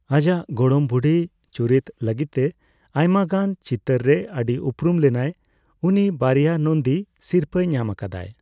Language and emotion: Santali, neutral